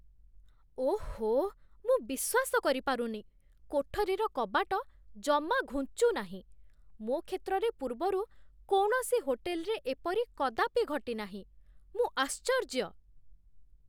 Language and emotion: Odia, surprised